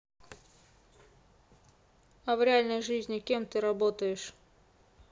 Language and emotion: Russian, neutral